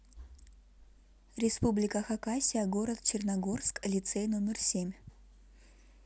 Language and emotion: Russian, neutral